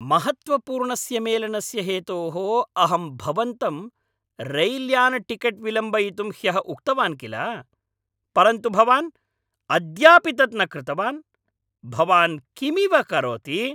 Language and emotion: Sanskrit, angry